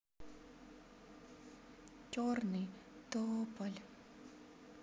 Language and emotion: Russian, sad